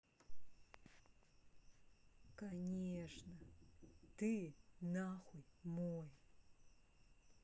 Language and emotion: Russian, angry